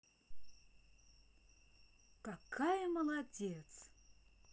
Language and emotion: Russian, positive